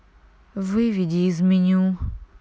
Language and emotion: Russian, neutral